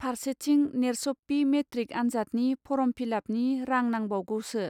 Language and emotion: Bodo, neutral